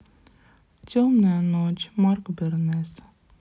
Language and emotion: Russian, sad